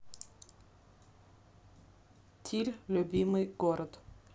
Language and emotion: Russian, neutral